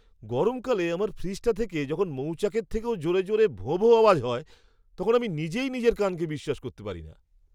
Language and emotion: Bengali, surprised